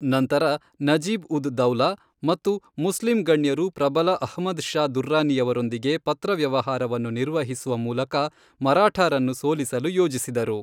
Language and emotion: Kannada, neutral